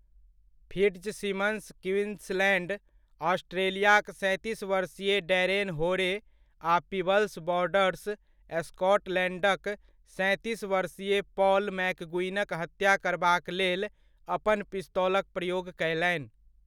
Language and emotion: Maithili, neutral